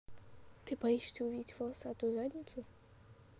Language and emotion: Russian, neutral